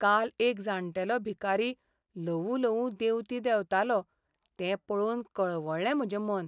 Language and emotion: Goan Konkani, sad